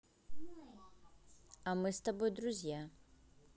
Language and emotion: Russian, neutral